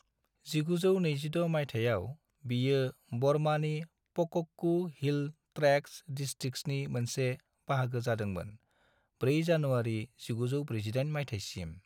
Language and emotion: Bodo, neutral